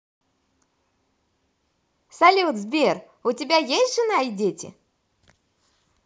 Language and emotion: Russian, positive